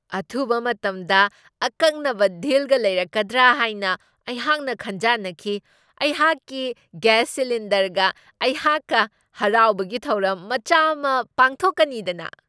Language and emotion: Manipuri, surprised